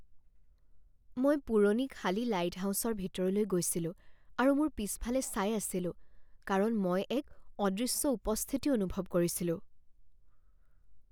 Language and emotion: Assamese, fearful